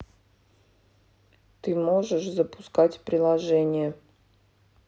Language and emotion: Russian, neutral